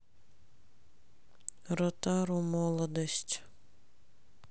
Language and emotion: Russian, sad